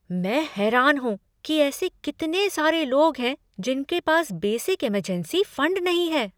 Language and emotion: Hindi, surprised